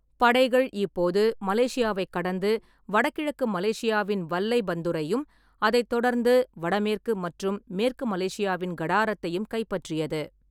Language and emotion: Tamil, neutral